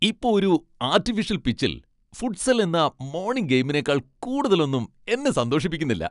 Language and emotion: Malayalam, happy